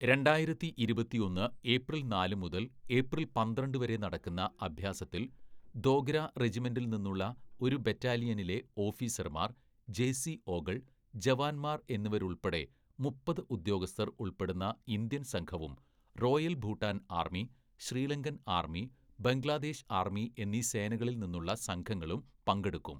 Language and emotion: Malayalam, neutral